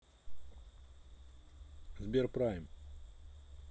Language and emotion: Russian, neutral